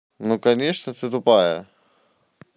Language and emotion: Russian, neutral